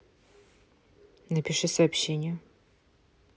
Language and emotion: Russian, neutral